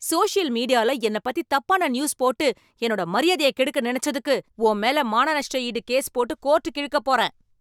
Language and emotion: Tamil, angry